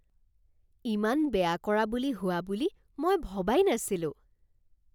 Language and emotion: Assamese, surprised